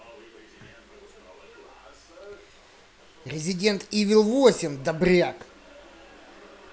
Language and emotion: Russian, angry